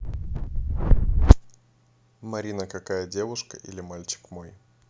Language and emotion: Russian, neutral